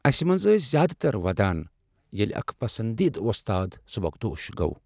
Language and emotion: Kashmiri, sad